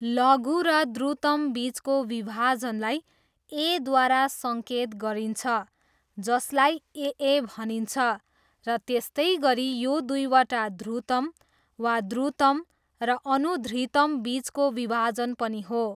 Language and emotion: Nepali, neutral